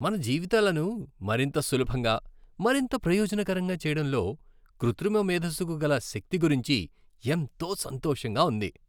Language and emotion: Telugu, happy